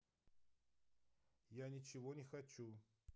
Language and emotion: Russian, neutral